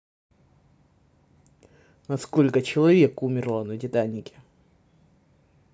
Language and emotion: Russian, neutral